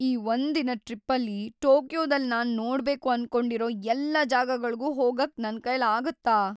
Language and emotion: Kannada, fearful